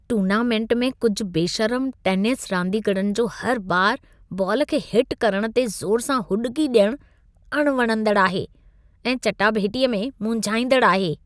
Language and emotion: Sindhi, disgusted